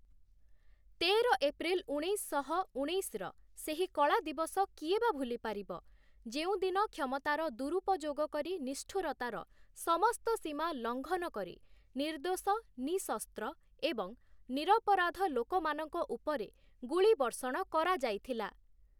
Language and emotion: Odia, neutral